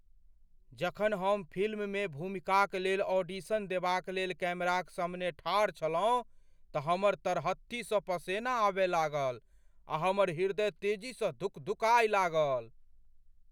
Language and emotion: Maithili, fearful